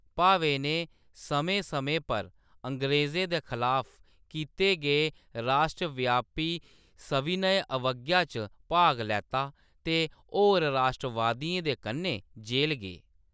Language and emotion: Dogri, neutral